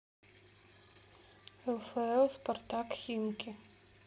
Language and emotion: Russian, neutral